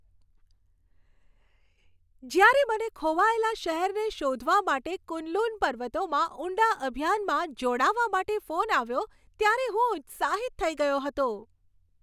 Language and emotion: Gujarati, happy